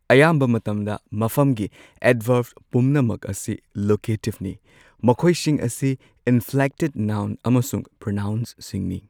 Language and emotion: Manipuri, neutral